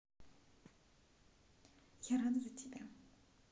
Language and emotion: Russian, neutral